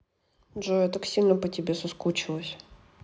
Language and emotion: Russian, neutral